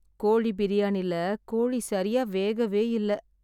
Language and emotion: Tamil, sad